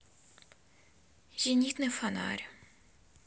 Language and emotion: Russian, sad